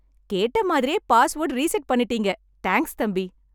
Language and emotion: Tamil, happy